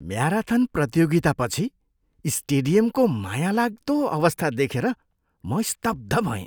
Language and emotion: Nepali, disgusted